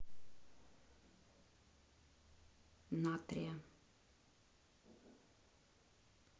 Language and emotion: Russian, neutral